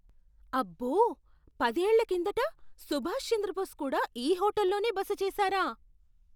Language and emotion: Telugu, surprised